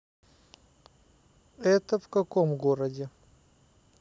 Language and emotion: Russian, neutral